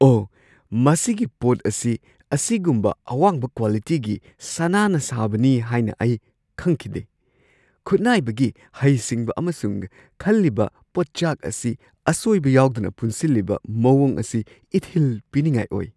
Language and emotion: Manipuri, surprised